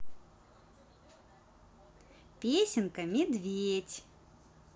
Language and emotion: Russian, positive